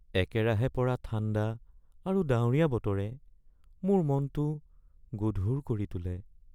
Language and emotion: Assamese, sad